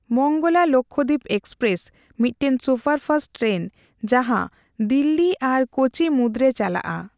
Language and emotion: Santali, neutral